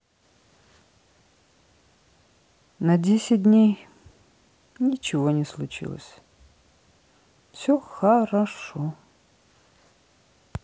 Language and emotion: Russian, sad